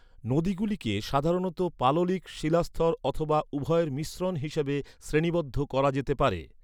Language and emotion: Bengali, neutral